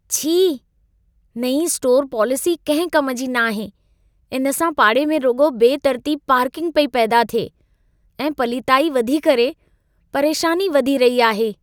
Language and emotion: Sindhi, disgusted